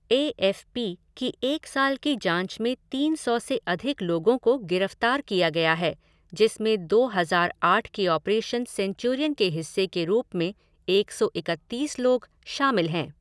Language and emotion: Hindi, neutral